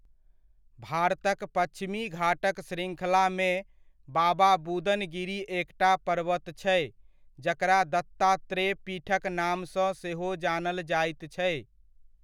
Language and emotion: Maithili, neutral